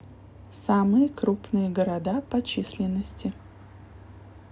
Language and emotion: Russian, neutral